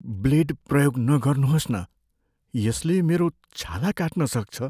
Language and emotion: Nepali, fearful